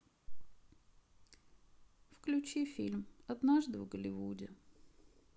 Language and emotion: Russian, sad